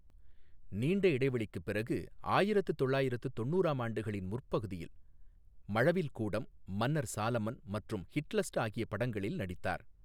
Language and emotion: Tamil, neutral